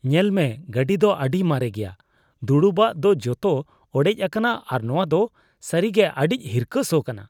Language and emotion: Santali, disgusted